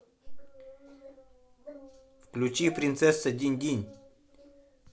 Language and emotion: Russian, neutral